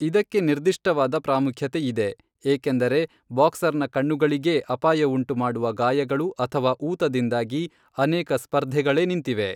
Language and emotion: Kannada, neutral